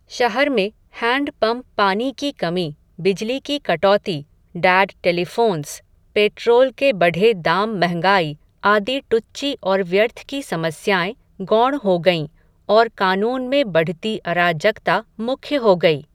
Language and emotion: Hindi, neutral